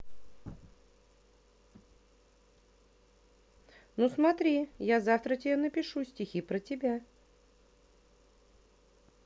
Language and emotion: Russian, positive